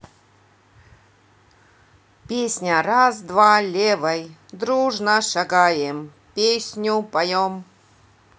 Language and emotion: Russian, positive